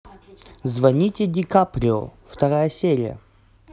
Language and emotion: Russian, positive